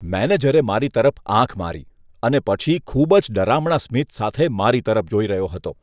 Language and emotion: Gujarati, disgusted